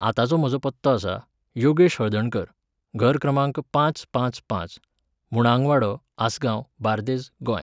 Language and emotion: Goan Konkani, neutral